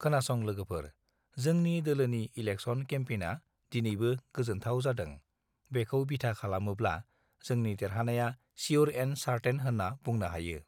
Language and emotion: Bodo, neutral